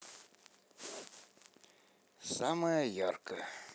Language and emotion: Russian, neutral